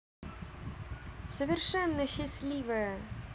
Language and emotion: Russian, positive